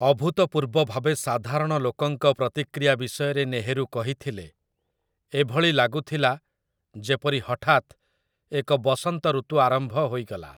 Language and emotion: Odia, neutral